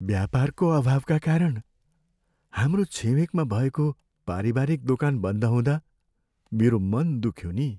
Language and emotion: Nepali, sad